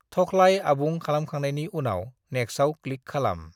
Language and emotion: Bodo, neutral